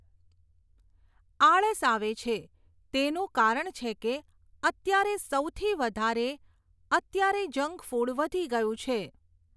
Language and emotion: Gujarati, neutral